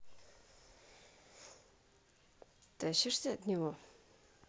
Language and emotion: Russian, neutral